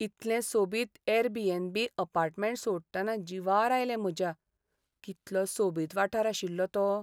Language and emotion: Goan Konkani, sad